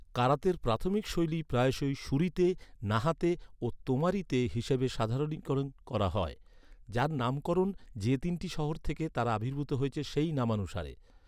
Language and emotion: Bengali, neutral